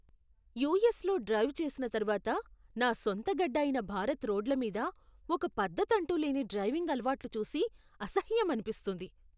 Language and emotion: Telugu, disgusted